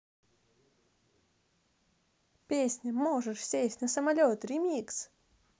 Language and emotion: Russian, positive